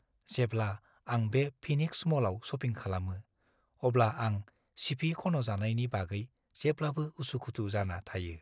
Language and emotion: Bodo, fearful